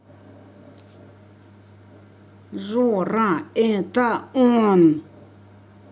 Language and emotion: Russian, angry